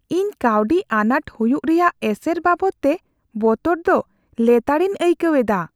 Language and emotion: Santali, fearful